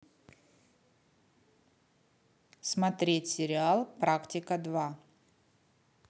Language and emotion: Russian, neutral